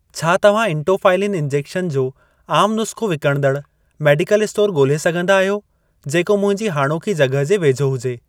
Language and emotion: Sindhi, neutral